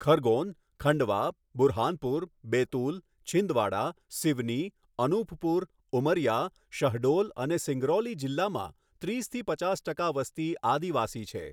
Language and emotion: Gujarati, neutral